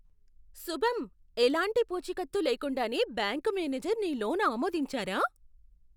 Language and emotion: Telugu, surprised